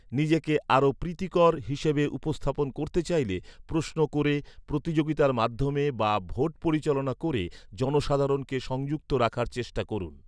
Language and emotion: Bengali, neutral